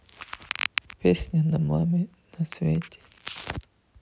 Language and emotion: Russian, sad